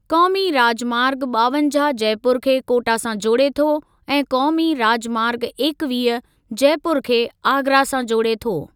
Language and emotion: Sindhi, neutral